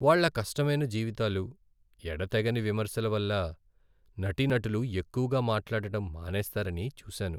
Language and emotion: Telugu, sad